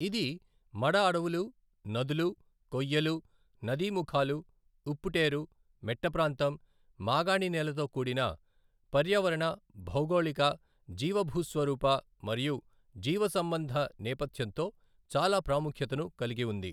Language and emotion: Telugu, neutral